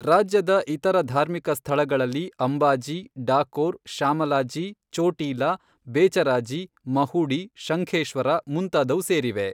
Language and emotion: Kannada, neutral